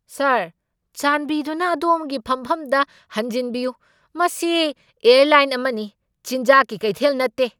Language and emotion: Manipuri, angry